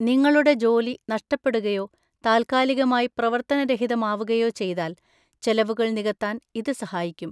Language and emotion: Malayalam, neutral